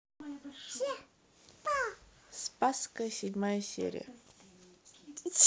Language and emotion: Russian, neutral